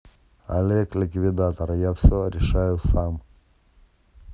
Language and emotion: Russian, neutral